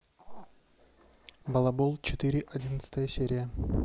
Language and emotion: Russian, neutral